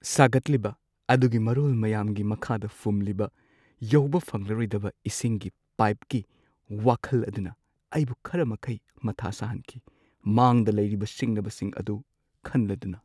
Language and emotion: Manipuri, sad